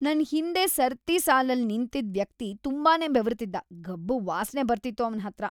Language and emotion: Kannada, disgusted